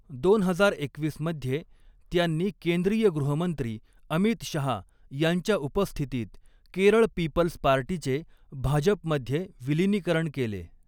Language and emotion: Marathi, neutral